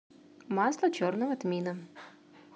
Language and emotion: Russian, neutral